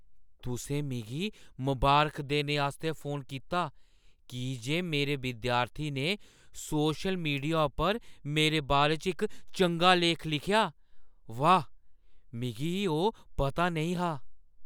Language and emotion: Dogri, surprised